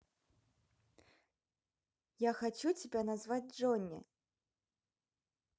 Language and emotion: Russian, positive